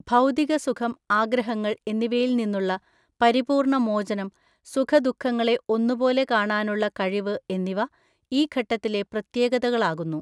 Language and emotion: Malayalam, neutral